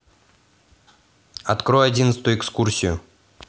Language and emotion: Russian, neutral